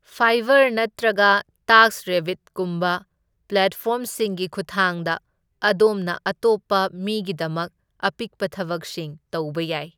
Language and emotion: Manipuri, neutral